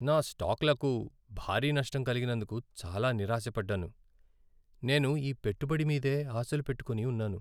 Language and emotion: Telugu, sad